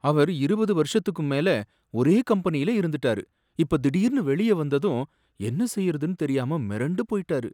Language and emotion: Tamil, sad